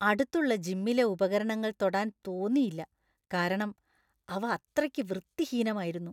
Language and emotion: Malayalam, disgusted